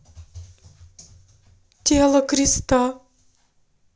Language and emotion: Russian, sad